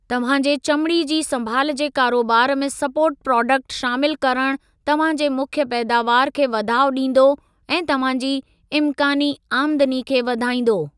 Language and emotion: Sindhi, neutral